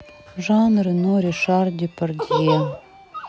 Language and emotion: Russian, sad